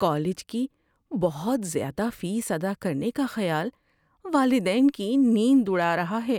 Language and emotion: Urdu, fearful